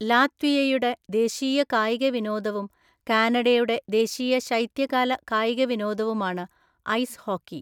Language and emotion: Malayalam, neutral